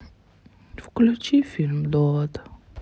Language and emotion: Russian, sad